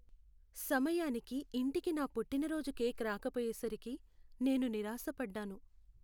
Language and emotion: Telugu, sad